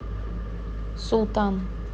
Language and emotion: Russian, neutral